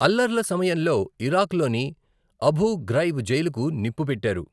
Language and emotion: Telugu, neutral